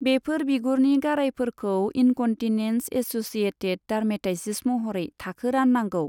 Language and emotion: Bodo, neutral